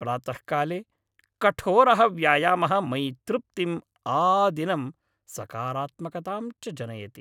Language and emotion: Sanskrit, happy